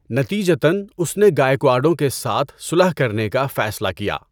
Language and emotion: Urdu, neutral